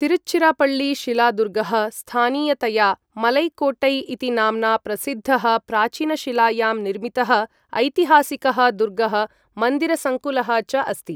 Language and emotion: Sanskrit, neutral